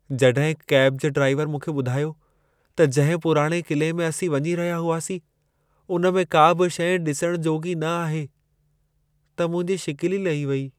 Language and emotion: Sindhi, sad